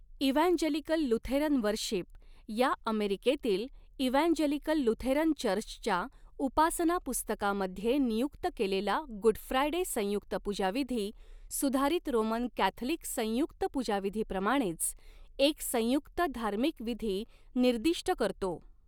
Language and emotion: Marathi, neutral